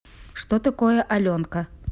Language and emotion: Russian, neutral